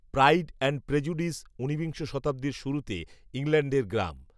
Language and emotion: Bengali, neutral